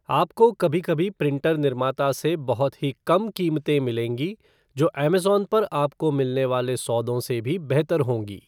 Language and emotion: Hindi, neutral